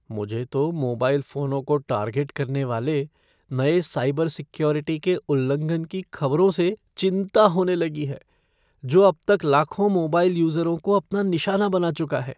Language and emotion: Hindi, fearful